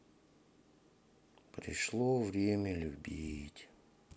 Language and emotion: Russian, sad